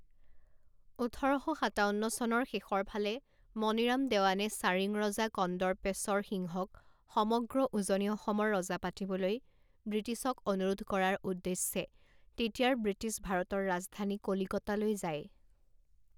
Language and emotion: Assamese, neutral